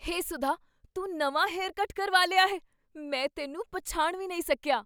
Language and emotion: Punjabi, surprised